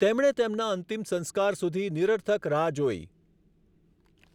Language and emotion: Gujarati, neutral